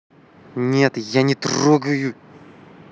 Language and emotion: Russian, angry